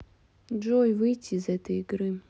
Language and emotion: Russian, sad